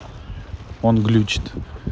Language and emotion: Russian, neutral